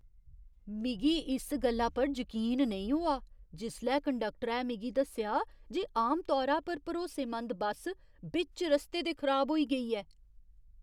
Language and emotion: Dogri, surprised